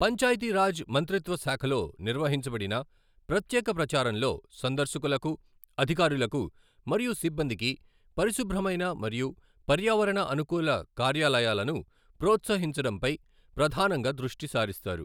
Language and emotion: Telugu, neutral